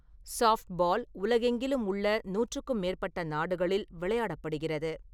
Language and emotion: Tamil, neutral